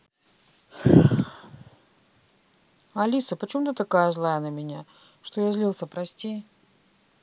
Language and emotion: Russian, sad